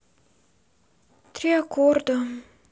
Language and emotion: Russian, sad